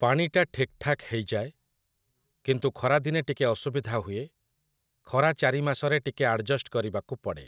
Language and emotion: Odia, neutral